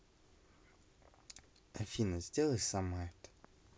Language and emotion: Russian, neutral